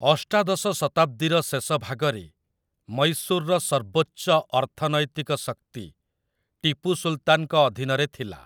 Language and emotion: Odia, neutral